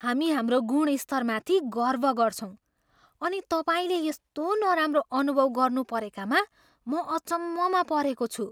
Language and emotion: Nepali, surprised